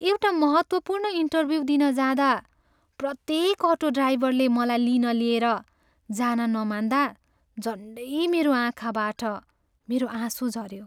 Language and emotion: Nepali, sad